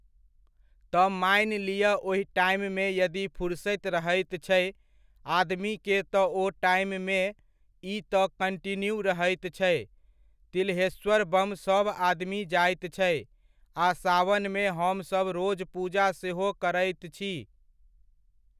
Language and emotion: Maithili, neutral